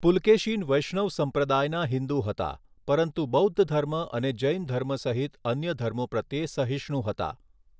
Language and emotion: Gujarati, neutral